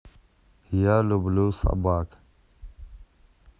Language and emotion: Russian, neutral